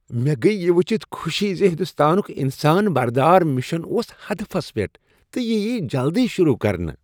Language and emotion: Kashmiri, happy